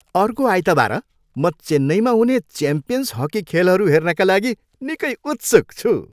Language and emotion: Nepali, happy